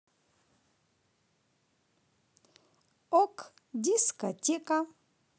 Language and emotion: Russian, positive